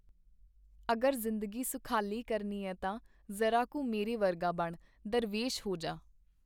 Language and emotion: Punjabi, neutral